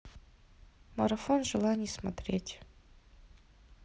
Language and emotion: Russian, neutral